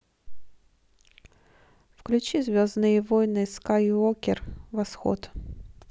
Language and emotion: Russian, neutral